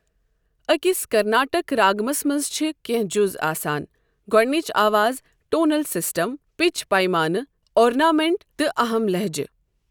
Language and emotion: Kashmiri, neutral